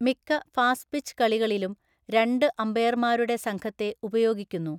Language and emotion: Malayalam, neutral